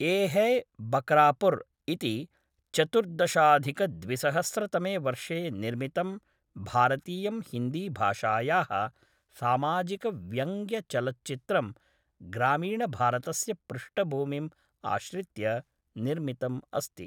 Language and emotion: Sanskrit, neutral